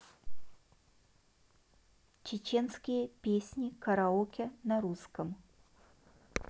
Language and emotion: Russian, neutral